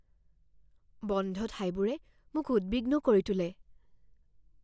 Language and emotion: Assamese, fearful